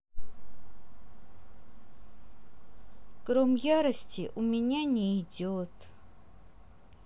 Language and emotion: Russian, sad